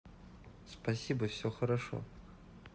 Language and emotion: Russian, neutral